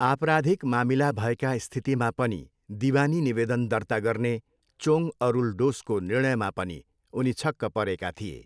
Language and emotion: Nepali, neutral